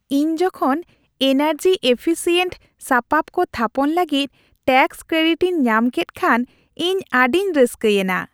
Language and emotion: Santali, happy